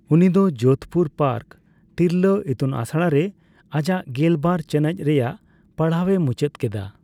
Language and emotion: Santali, neutral